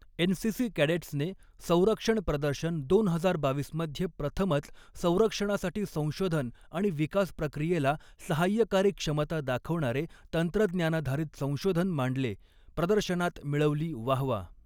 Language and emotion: Marathi, neutral